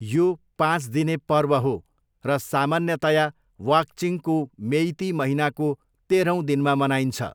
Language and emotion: Nepali, neutral